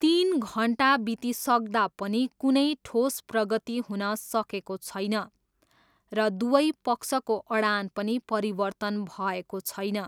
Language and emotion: Nepali, neutral